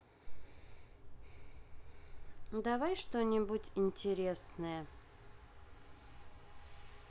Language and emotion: Russian, neutral